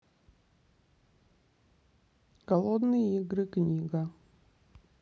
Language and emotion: Russian, neutral